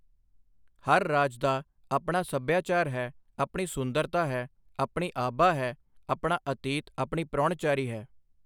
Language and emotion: Punjabi, neutral